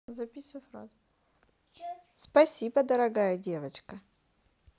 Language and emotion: Russian, positive